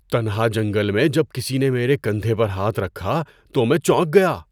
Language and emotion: Urdu, surprised